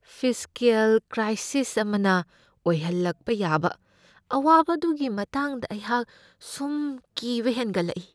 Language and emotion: Manipuri, fearful